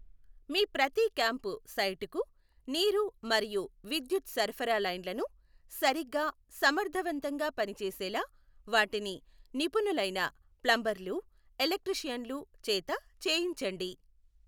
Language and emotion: Telugu, neutral